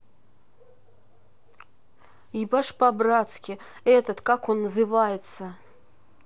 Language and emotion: Russian, neutral